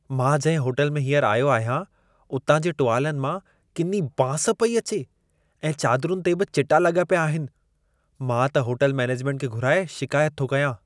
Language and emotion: Sindhi, disgusted